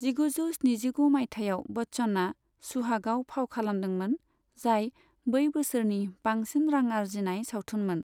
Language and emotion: Bodo, neutral